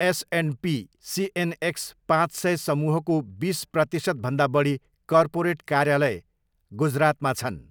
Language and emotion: Nepali, neutral